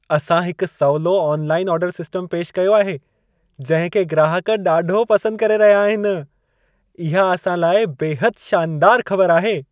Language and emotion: Sindhi, happy